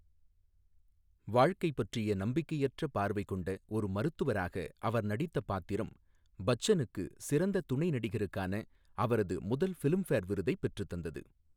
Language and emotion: Tamil, neutral